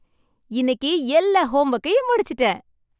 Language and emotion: Tamil, happy